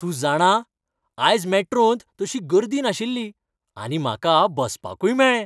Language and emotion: Goan Konkani, happy